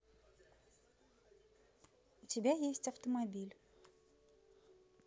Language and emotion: Russian, neutral